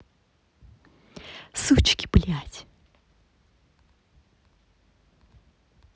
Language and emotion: Russian, angry